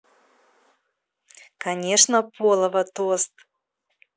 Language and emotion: Russian, positive